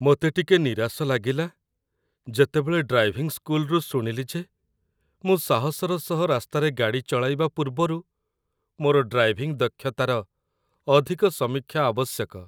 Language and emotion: Odia, sad